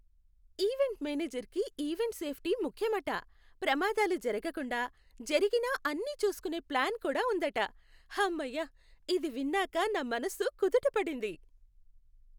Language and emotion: Telugu, happy